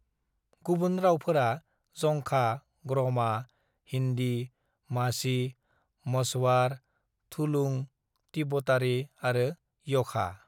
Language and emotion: Bodo, neutral